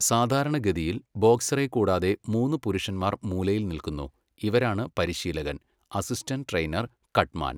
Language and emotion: Malayalam, neutral